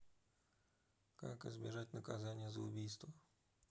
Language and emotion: Russian, neutral